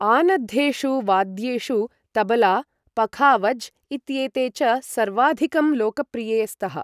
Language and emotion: Sanskrit, neutral